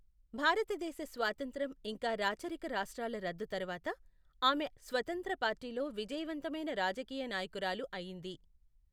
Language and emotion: Telugu, neutral